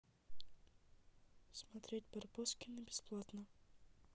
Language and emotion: Russian, neutral